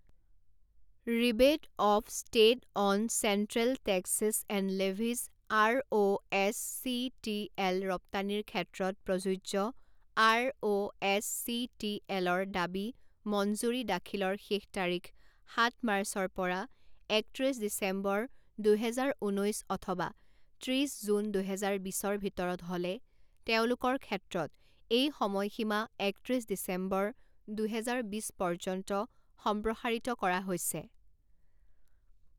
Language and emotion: Assamese, neutral